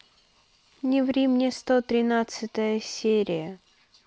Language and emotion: Russian, neutral